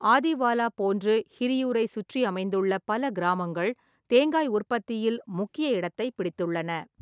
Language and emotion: Tamil, neutral